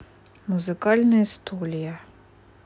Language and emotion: Russian, neutral